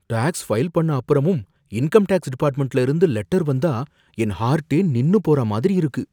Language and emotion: Tamil, fearful